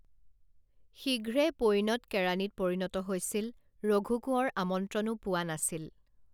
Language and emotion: Assamese, neutral